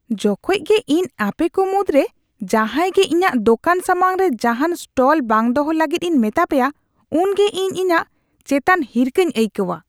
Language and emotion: Santali, disgusted